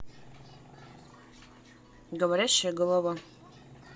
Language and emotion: Russian, neutral